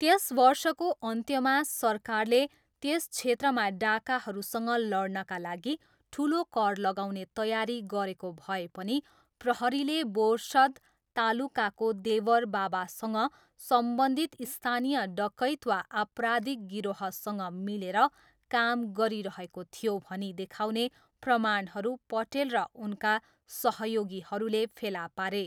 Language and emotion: Nepali, neutral